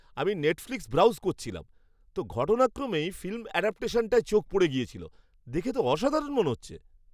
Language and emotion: Bengali, surprised